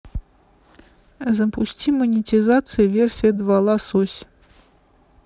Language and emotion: Russian, neutral